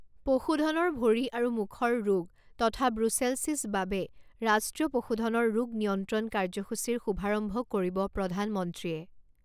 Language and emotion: Assamese, neutral